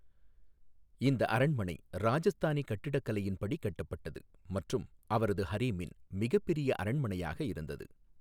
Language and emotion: Tamil, neutral